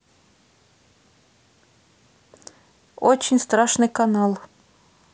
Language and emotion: Russian, neutral